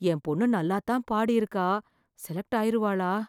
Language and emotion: Tamil, fearful